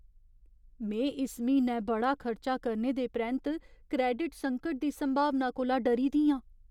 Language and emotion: Dogri, fearful